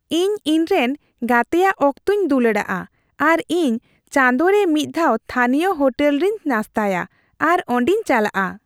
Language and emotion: Santali, happy